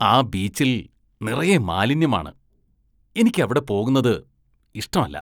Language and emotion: Malayalam, disgusted